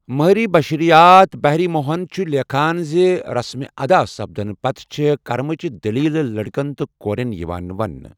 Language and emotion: Kashmiri, neutral